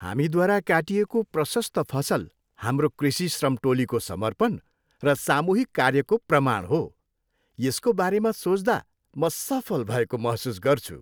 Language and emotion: Nepali, happy